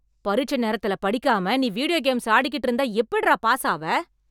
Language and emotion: Tamil, angry